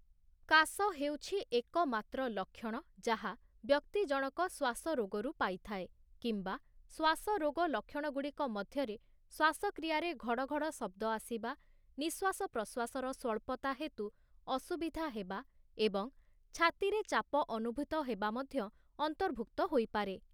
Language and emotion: Odia, neutral